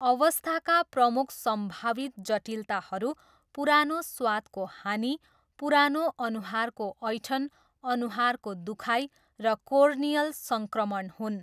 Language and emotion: Nepali, neutral